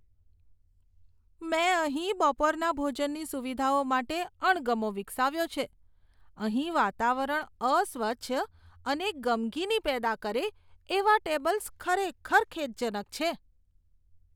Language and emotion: Gujarati, disgusted